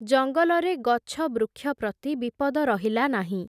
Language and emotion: Odia, neutral